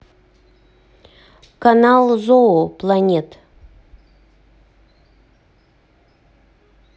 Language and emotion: Russian, neutral